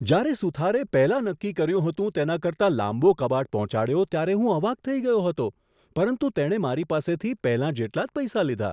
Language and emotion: Gujarati, surprised